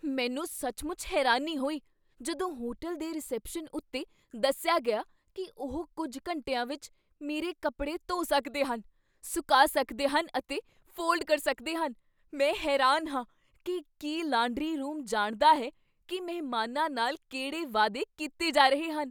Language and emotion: Punjabi, surprised